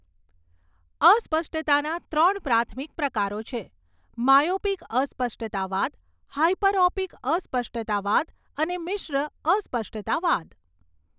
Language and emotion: Gujarati, neutral